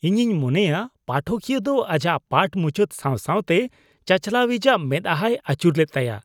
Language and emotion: Santali, disgusted